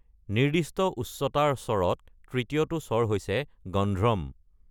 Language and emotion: Assamese, neutral